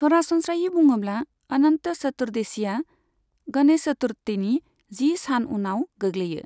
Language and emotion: Bodo, neutral